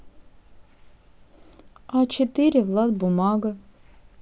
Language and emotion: Russian, neutral